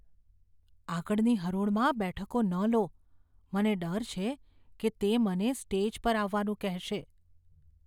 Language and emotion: Gujarati, fearful